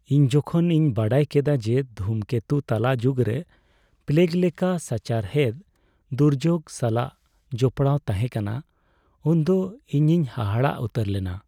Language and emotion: Santali, sad